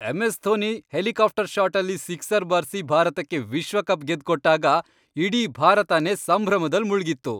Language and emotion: Kannada, happy